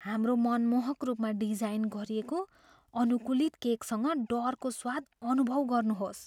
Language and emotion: Nepali, fearful